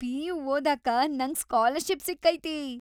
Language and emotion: Kannada, happy